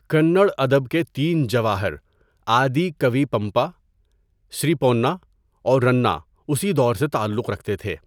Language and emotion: Urdu, neutral